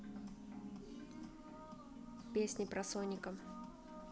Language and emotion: Russian, neutral